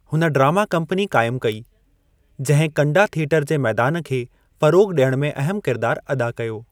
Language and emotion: Sindhi, neutral